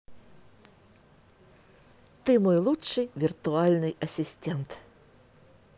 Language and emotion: Russian, positive